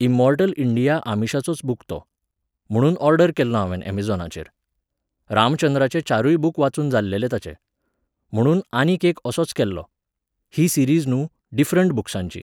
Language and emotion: Goan Konkani, neutral